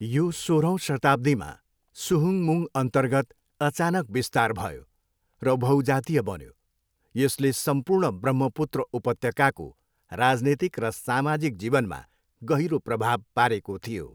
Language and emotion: Nepali, neutral